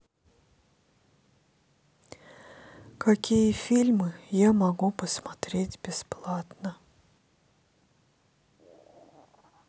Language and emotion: Russian, sad